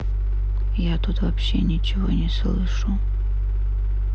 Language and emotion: Russian, sad